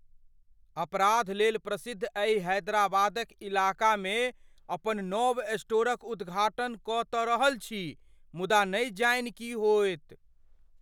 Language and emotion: Maithili, fearful